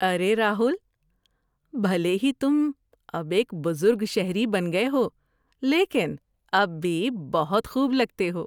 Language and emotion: Urdu, happy